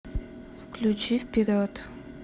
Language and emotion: Russian, neutral